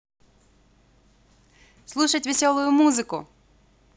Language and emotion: Russian, positive